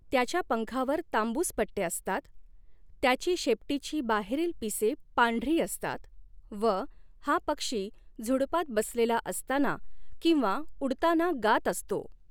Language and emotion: Marathi, neutral